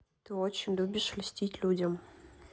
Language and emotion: Russian, neutral